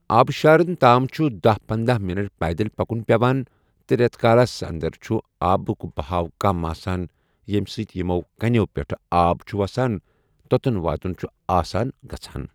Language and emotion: Kashmiri, neutral